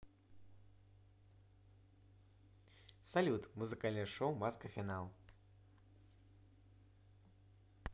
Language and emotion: Russian, positive